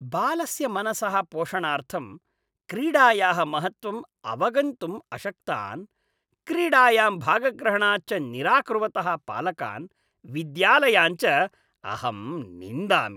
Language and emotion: Sanskrit, disgusted